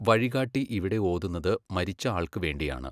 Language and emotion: Malayalam, neutral